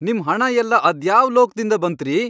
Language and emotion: Kannada, angry